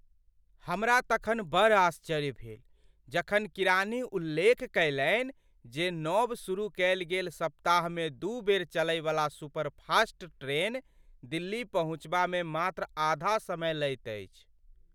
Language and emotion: Maithili, surprised